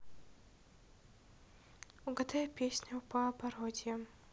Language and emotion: Russian, neutral